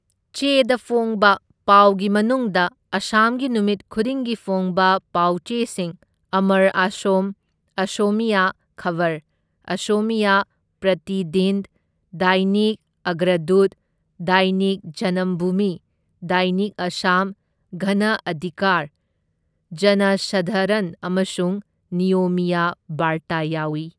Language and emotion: Manipuri, neutral